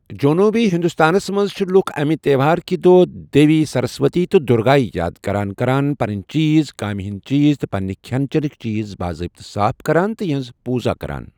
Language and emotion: Kashmiri, neutral